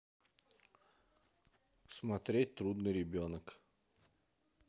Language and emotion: Russian, neutral